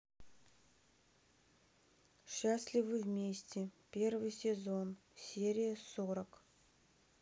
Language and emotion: Russian, neutral